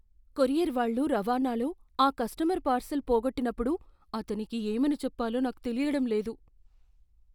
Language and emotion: Telugu, fearful